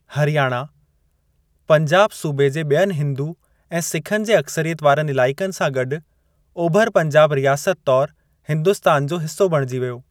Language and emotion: Sindhi, neutral